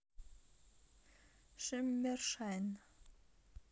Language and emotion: Russian, neutral